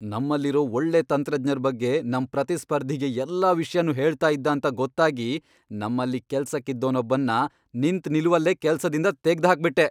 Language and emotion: Kannada, angry